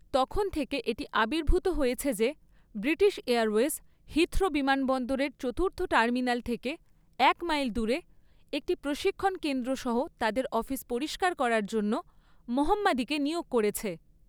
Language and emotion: Bengali, neutral